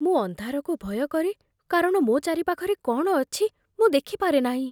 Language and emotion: Odia, fearful